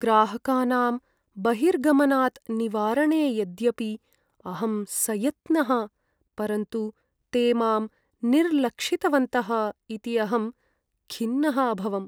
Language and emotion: Sanskrit, sad